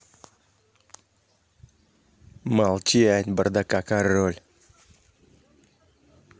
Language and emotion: Russian, angry